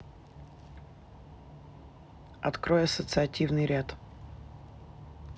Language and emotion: Russian, neutral